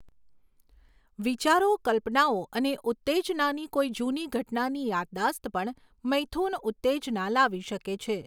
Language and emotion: Gujarati, neutral